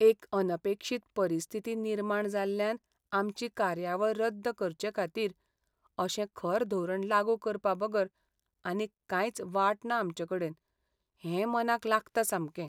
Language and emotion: Goan Konkani, sad